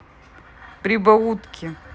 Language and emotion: Russian, neutral